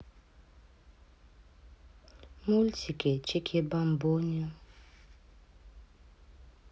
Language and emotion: Russian, neutral